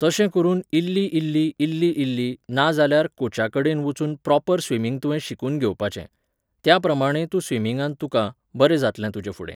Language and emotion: Goan Konkani, neutral